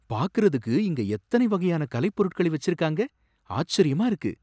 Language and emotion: Tamil, surprised